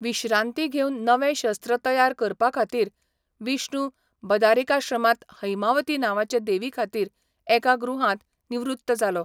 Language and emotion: Goan Konkani, neutral